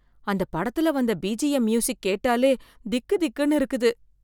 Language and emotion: Tamil, fearful